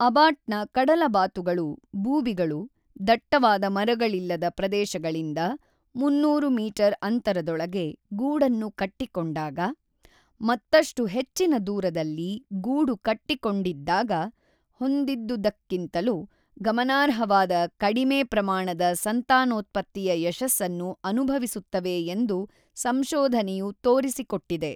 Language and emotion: Kannada, neutral